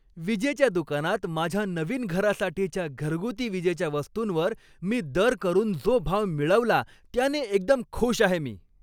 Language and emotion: Marathi, happy